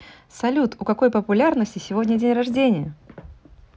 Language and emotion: Russian, positive